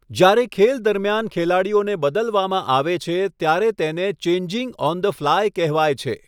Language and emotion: Gujarati, neutral